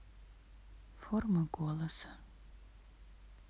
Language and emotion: Russian, sad